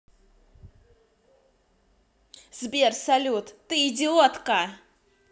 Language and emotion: Russian, angry